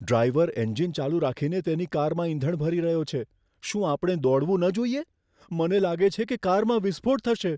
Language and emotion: Gujarati, fearful